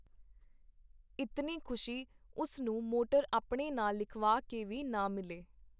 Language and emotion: Punjabi, neutral